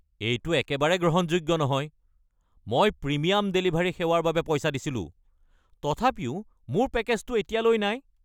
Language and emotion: Assamese, angry